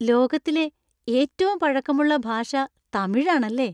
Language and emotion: Malayalam, happy